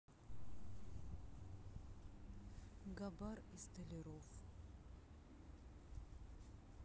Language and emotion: Russian, sad